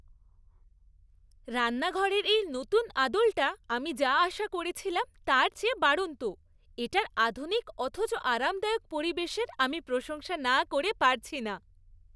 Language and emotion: Bengali, happy